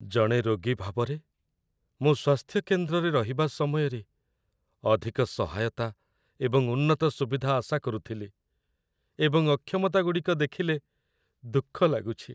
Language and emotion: Odia, sad